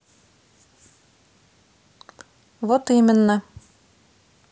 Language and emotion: Russian, neutral